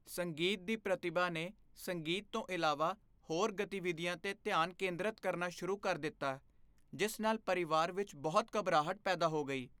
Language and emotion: Punjabi, fearful